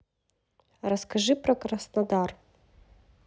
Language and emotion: Russian, neutral